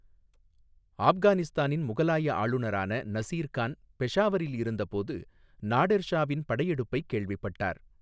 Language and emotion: Tamil, neutral